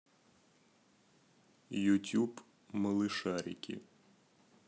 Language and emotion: Russian, neutral